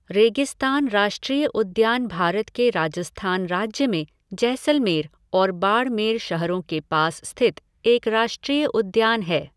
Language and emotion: Hindi, neutral